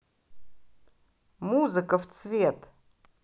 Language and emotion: Russian, positive